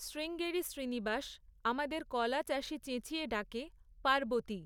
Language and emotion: Bengali, neutral